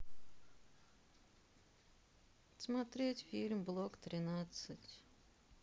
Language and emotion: Russian, sad